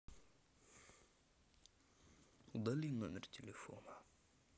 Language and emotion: Russian, sad